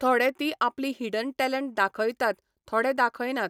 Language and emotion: Goan Konkani, neutral